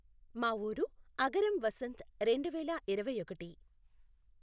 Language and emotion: Telugu, neutral